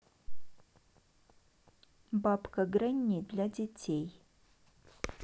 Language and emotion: Russian, neutral